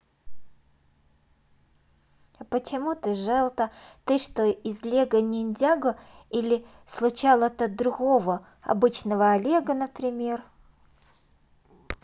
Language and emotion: Russian, neutral